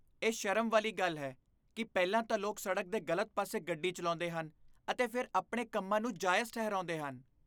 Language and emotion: Punjabi, disgusted